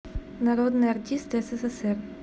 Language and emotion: Russian, neutral